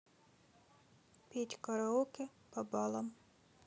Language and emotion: Russian, neutral